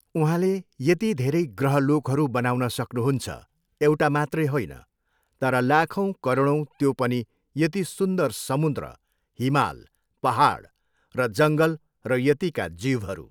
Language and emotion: Nepali, neutral